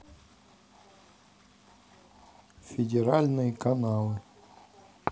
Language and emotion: Russian, neutral